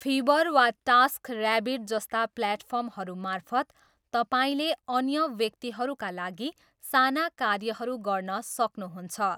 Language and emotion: Nepali, neutral